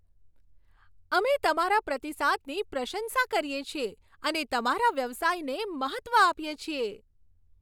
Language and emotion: Gujarati, happy